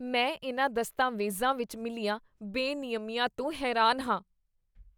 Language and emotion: Punjabi, disgusted